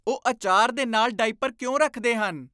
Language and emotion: Punjabi, disgusted